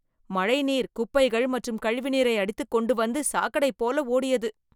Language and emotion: Tamil, disgusted